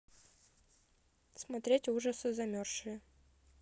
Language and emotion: Russian, neutral